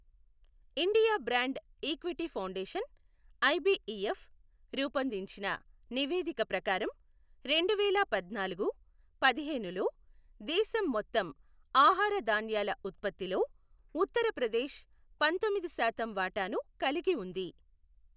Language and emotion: Telugu, neutral